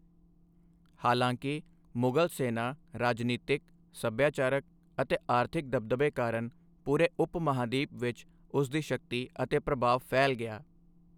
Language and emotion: Punjabi, neutral